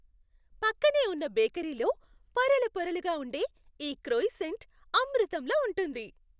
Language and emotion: Telugu, happy